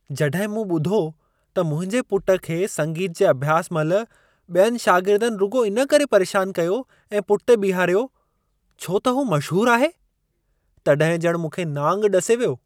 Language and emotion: Sindhi, surprised